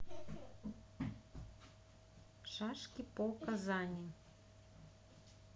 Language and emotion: Russian, neutral